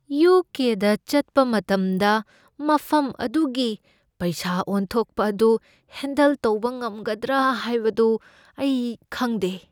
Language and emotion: Manipuri, fearful